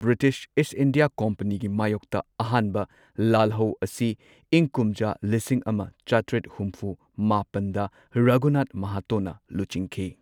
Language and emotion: Manipuri, neutral